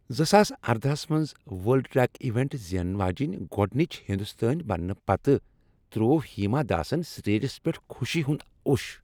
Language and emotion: Kashmiri, happy